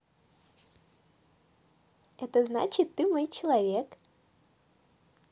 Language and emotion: Russian, positive